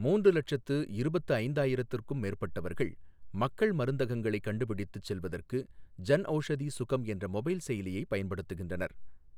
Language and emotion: Tamil, neutral